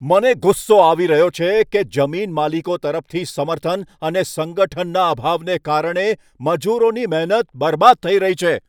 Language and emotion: Gujarati, angry